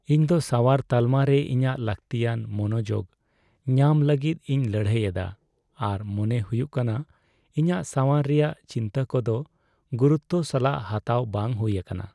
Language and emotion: Santali, sad